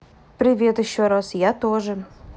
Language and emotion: Russian, neutral